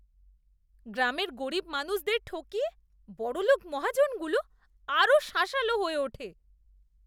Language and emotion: Bengali, disgusted